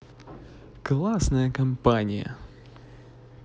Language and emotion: Russian, positive